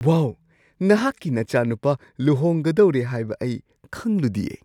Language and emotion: Manipuri, surprised